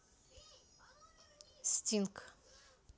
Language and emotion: Russian, neutral